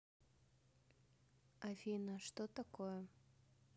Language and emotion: Russian, neutral